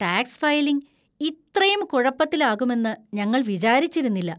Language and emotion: Malayalam, disgusted